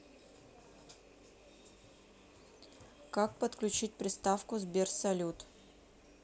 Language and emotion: Russian, neutral